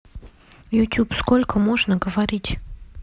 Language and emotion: Russian, neutral